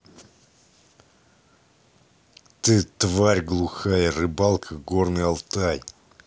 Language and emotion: Russian, angry